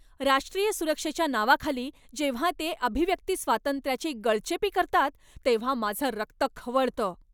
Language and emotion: Marathi, angry